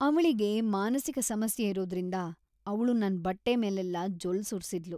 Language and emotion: Kannada, disgusted